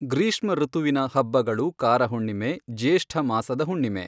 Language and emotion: Kannada, neutral